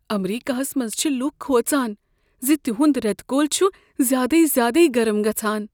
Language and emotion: Kashmiri, fearful